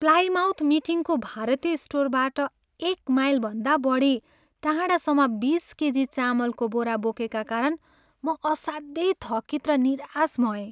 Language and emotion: Nepali, sad